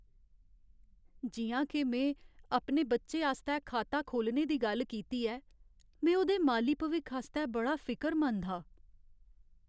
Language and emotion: Dogri, sad